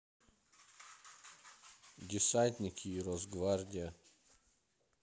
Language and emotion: Russian, neutral